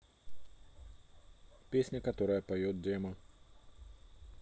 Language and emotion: Russian, neutral